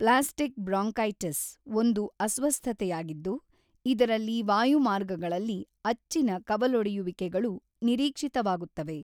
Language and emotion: Kannada, neutral